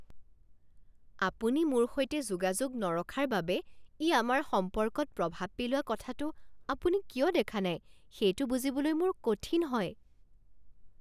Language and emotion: Assamese, surprised